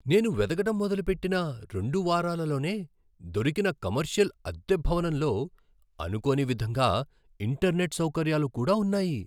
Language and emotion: Telugu, surprised